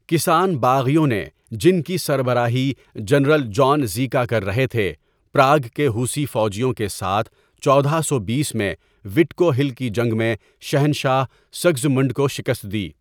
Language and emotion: Urdu, neutral